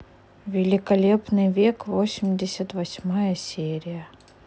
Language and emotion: Russian, neutral